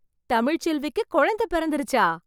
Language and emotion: Tamil, surprised